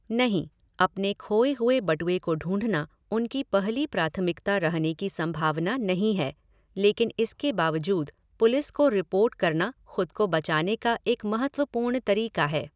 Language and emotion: Hindi, neutral